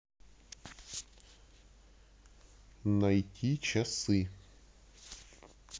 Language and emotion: Russian, neutral